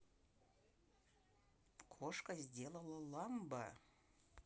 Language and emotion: Russian, neutral